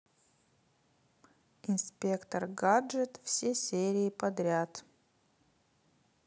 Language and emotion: Russian, neutral